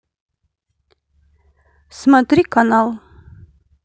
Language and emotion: Russian, neutral